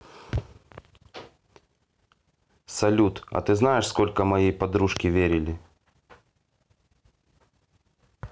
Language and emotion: Russian, neutral